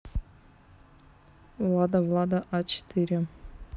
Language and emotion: Russian, neutral